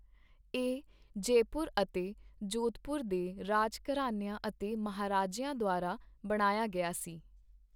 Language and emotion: Punjabi, neutral